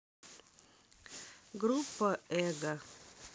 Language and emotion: Russian, neutral